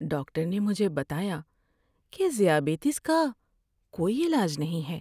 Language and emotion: Urdu, sad